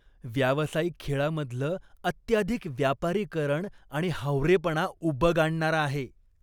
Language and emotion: Marathi, disgusted